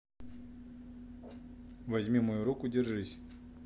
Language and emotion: Russian, neutral